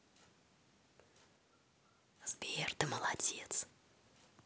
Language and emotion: Russian, positive